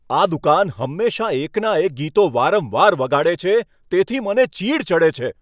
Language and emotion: Gujarati, angry